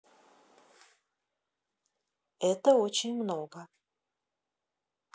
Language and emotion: Russian, neutral